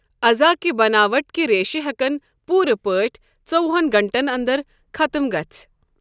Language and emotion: Kashmiri, neutral